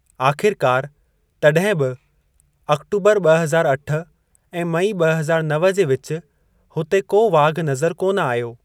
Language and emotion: Sindhi, neutral